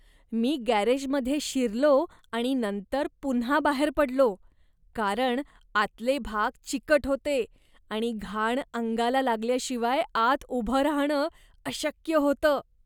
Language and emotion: Marathi, disgusted